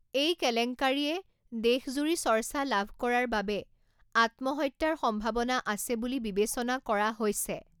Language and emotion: Assamese, neutral